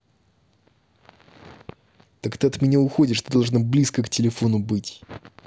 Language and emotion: Russian, angry